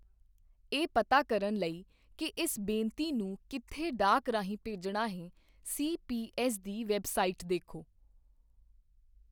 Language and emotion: Punjabi, neutral